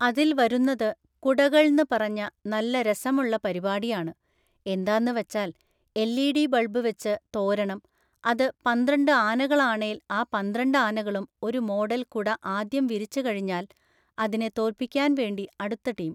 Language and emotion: Malayalam, neutral